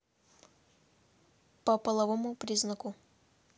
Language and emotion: Russian, neutral